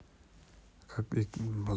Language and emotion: Russian, neutral